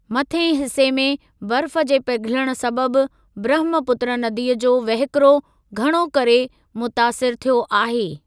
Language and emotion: Sindhi, neutral